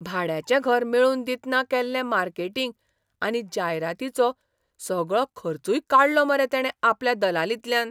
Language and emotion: Goan Konkani, surprised